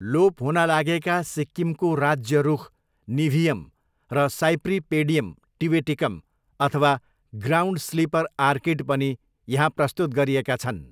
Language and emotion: Nepali, neutral